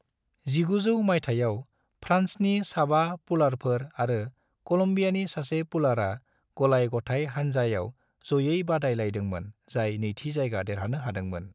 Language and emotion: Bodo, neutral